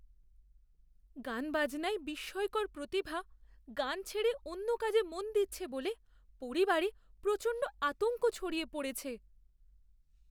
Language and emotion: Bengali, fearful